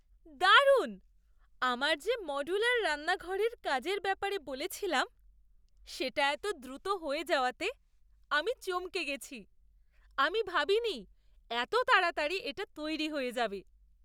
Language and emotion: Bengali, surprised